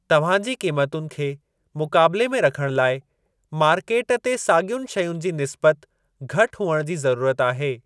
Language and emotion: Sindhi, neutral